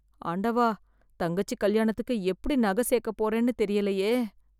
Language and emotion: Tamil, fearful